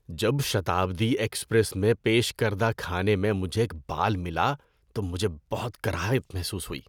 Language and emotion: Urdu, disgusted